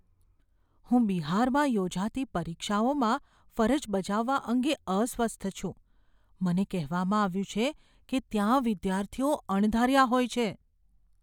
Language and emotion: Gujarati, fearful